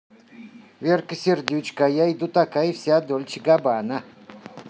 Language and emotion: Russian, positive